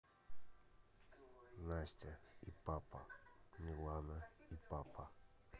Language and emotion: Russian, neutral